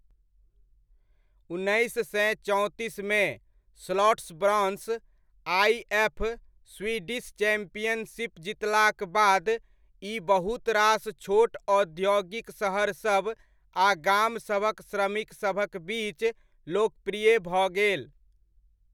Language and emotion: Maithili, neutral